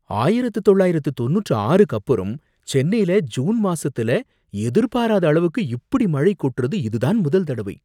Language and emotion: Tamil, surprised